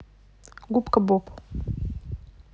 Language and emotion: Russian, neutral